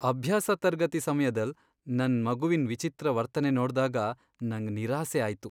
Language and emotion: Kannada, sad